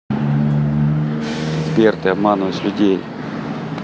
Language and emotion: Russian, neutral